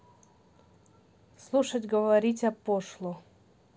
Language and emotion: Russian, neutral